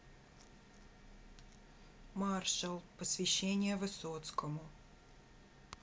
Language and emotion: Russian, neutral